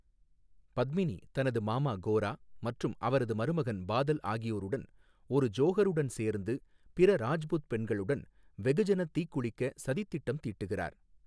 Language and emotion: Tamil, neutral